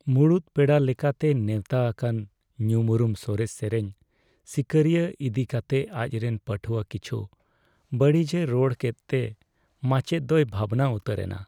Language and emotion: Santali, sad